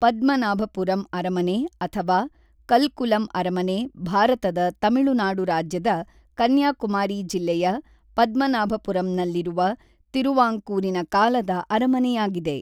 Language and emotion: Kannada, neutral